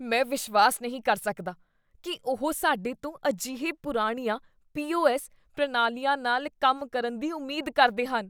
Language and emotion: Punjabi, disgusted